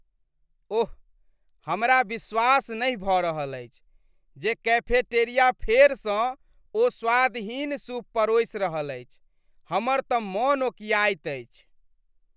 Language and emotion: Maithili, disgusted